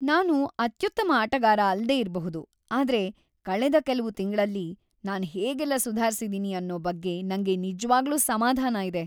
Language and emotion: Kannada, happy